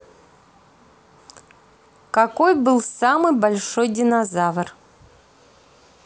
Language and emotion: Russian, neutral